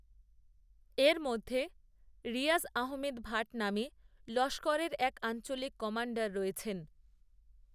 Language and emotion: Bengali, neutral